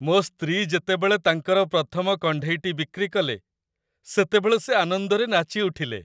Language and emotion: Odia, happy